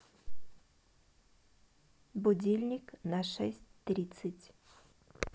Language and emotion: Russian, neutral